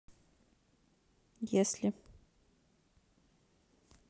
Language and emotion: Russian, neutral